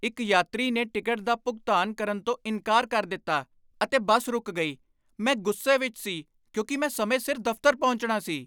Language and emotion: Punjabi, angry